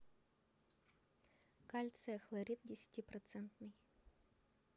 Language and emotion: Russian, neutral